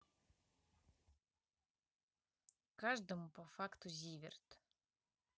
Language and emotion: Russian, neutral